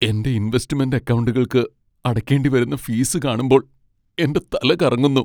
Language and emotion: Malayalam, sad